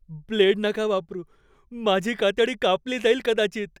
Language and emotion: Marathi, fearful